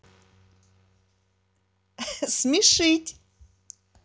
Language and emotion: Russian, positive